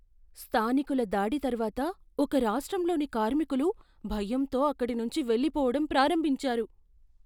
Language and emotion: Telugu, fearful